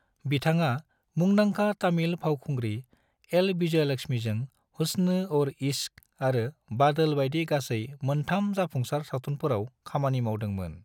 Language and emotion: Bodo, neutral